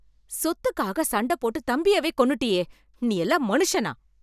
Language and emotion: Tamil, angry